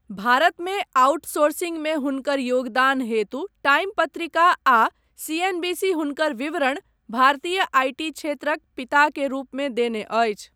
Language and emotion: Maithili, neutral